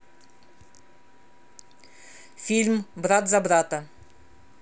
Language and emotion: Russian, neutral